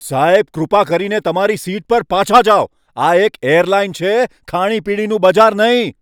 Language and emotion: Gujarati, angry